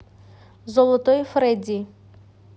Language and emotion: Russian, neutral